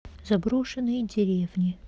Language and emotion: Russian, neutral